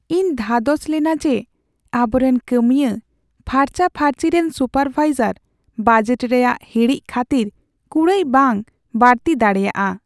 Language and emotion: Santali, sad